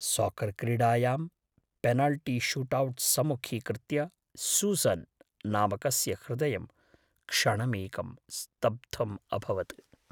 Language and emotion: Sanskrit, fearful